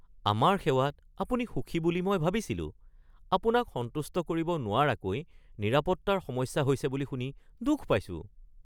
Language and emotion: Assamese, surprised